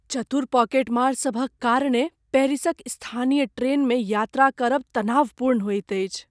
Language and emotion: Maithili, fearful